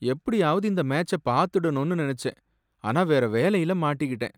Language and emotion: Tamil, sad